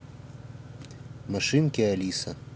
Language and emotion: Russian, neutral